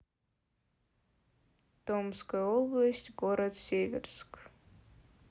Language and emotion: Russian, sad